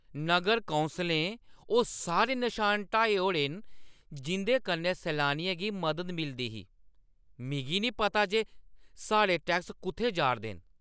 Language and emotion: Dogri, angry